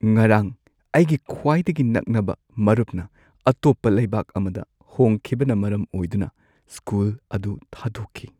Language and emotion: Manipuri, sad